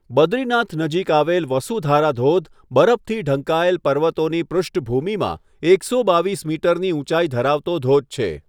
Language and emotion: Gujarati, neutral